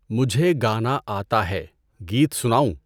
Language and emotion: Urdu, neutral